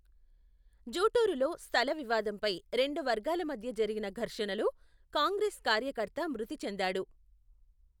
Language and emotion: Telugu, neutral